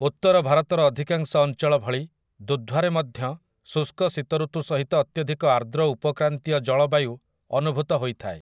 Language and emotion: Odia, neutral